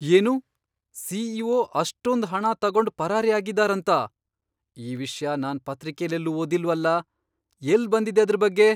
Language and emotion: Kannada, surprised